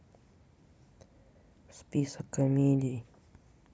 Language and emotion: Russian, sad